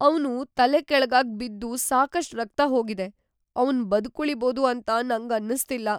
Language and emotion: Kannada, fearful